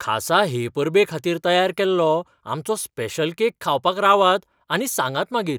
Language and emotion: Goan Konkani, surprised